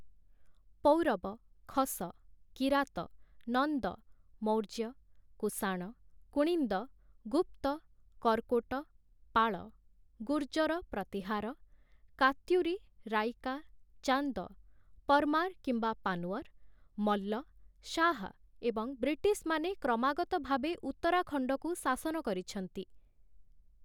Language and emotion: Odia, neutral